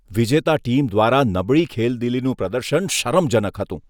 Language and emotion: Gujarati, disgusted